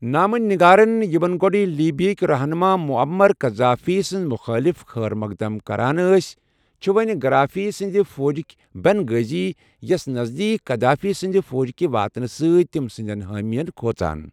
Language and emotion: Kashmiri, neutral